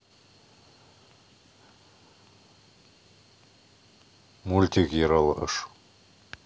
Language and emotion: Russian, neutral